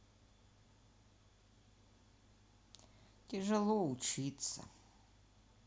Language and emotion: Russian, sad